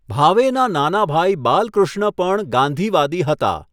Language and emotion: Gujarati, neutral